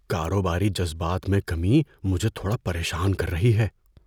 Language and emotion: Urdu, fearful